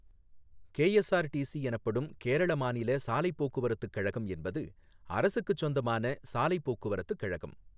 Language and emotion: Tamil, neutral